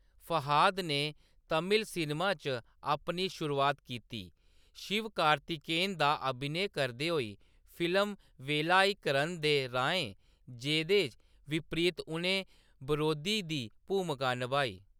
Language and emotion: Dogri, neutral